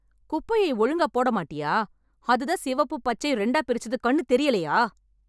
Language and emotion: Tamil, angry